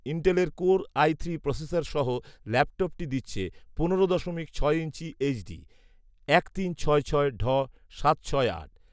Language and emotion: Bengali, neutral